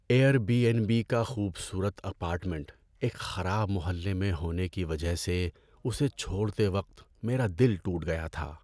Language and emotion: Urdu, sad